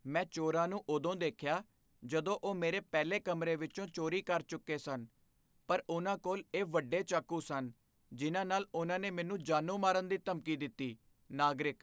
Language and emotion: Punjabi, fearful